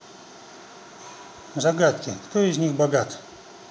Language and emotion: Russian, neutral